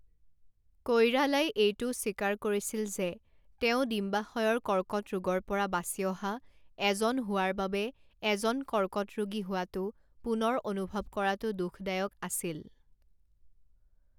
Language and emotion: Assamese, neutral